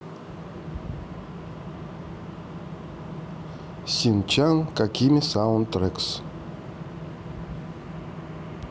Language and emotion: Russian, neutral